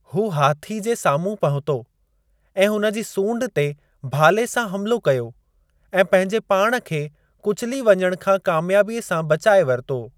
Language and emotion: Sindhi, neutral